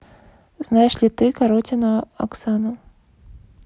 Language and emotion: Russian, neutral